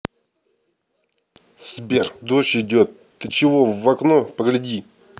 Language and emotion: Russian, angry